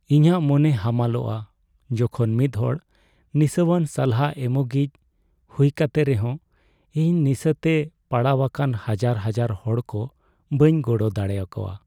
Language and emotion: Santali, sad